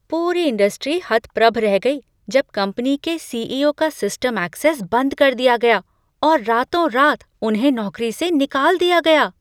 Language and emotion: Hindi, surprised